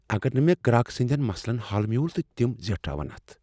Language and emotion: Kashmiri, fearful